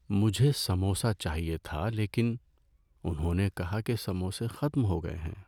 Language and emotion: Urdu, sad